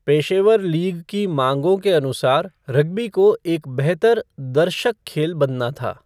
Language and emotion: Hindi, neutral